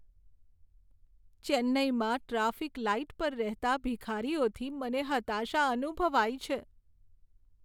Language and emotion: Gujarati, sad